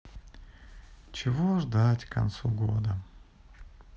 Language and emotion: Russian, sad